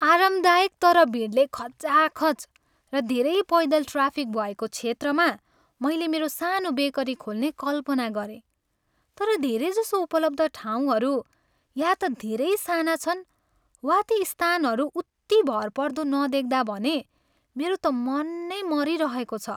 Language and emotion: Nepali, sad